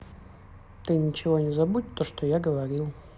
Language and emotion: Russian, neutral